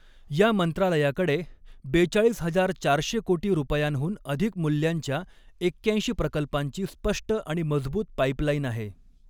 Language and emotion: Marathi, neutral